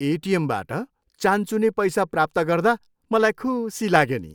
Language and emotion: Nepali, happy